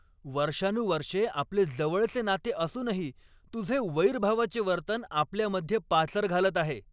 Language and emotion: Marathi, angry